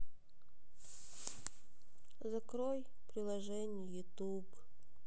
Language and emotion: Russian, sad